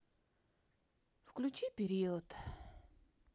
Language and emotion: Russian, neutral